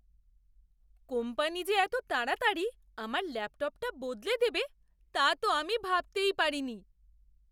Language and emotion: Bengali, surprised